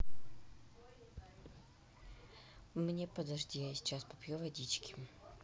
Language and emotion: Russian, neutral